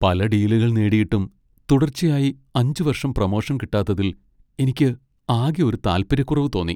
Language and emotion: Malayalam, sad